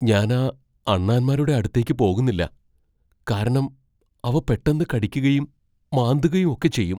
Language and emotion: Malayalam, fearful